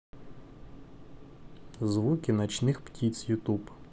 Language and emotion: Russian, neutral